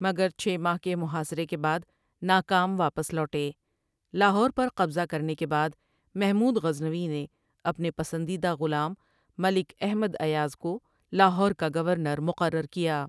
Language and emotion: Urdu, neutral